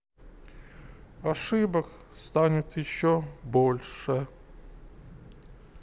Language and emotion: Russian, sad